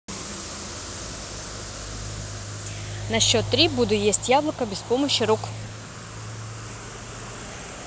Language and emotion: Russian, neutral